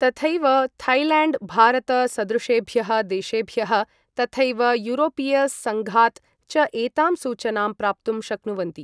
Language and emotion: Sanskrit, neutral